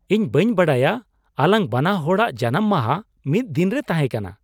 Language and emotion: Santali, surprised